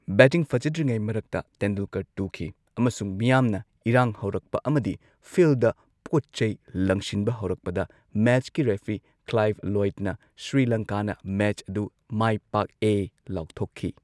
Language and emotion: Manipuri, neutral